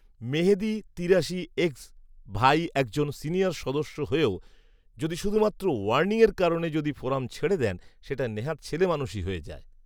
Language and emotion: Bengali, neutral